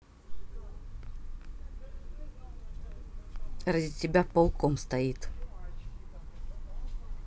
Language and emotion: Russian, neutral